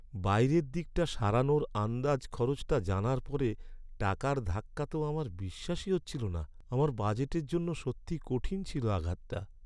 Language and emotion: Bengali, sad